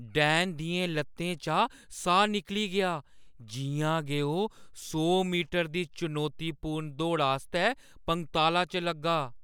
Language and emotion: Dogri, fearful